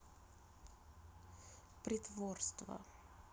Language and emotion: Russian, sad